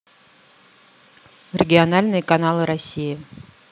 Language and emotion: Russian, neutral